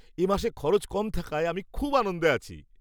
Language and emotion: Bengali, happy